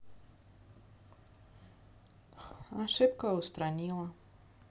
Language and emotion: Russian, neutral